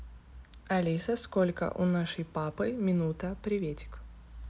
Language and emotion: Russian, neutral